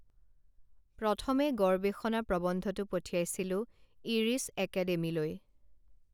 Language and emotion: Assamese, neutral